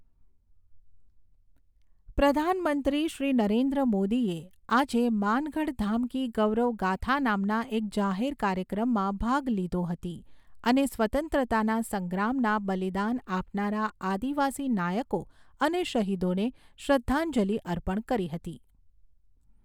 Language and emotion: Gujarati, neutral